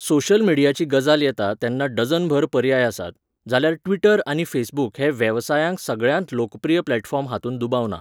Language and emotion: Goan Konkani, neutral